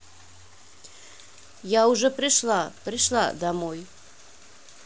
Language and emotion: Russian, neutral